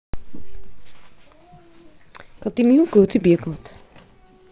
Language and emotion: Russian, neutral